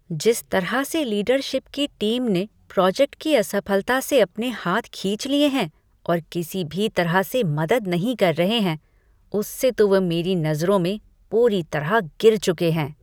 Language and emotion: Hindi, disgusted